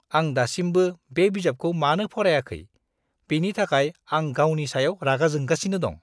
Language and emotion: Bodo, disgusted